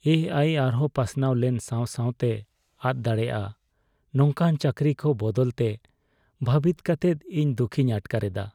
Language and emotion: Santali, sad